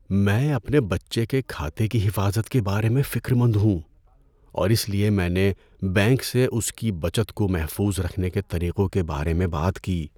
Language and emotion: Urdu, fearful